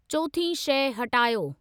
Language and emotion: Sindhi, neutral